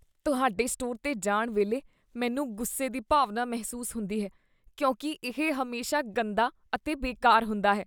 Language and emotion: Punjabi, disgusted